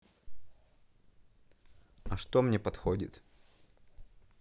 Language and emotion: Russian, neutral